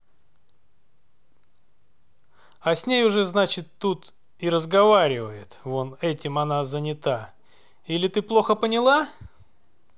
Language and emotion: Russian, angry